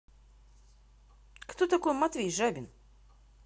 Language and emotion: Russian, neutral